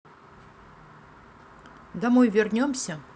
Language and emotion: Russian, neutral